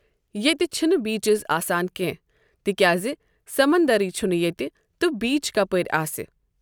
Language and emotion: Kashmiri, neutral